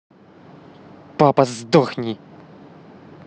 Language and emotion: Russian, angry